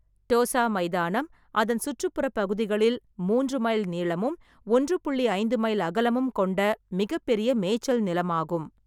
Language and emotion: Tamil, neutral